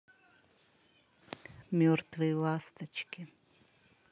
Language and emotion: Russian, neutral